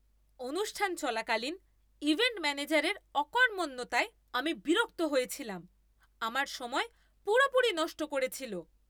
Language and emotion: Bengali, angry